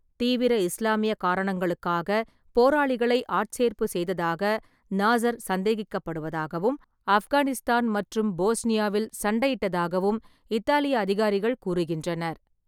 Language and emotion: Tamil, neutral